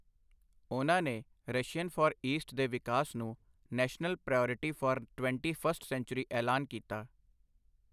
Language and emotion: Punjabi, neutral